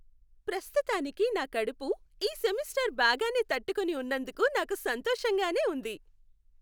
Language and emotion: Telugu, happy